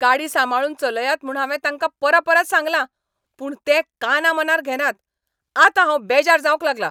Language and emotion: Goan Konkani, angry